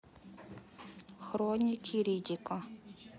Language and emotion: Russian, neutral